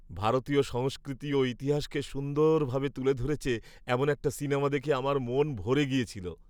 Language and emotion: Bengali, happy